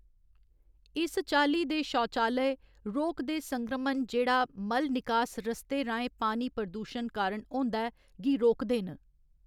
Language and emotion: Dogri, neutral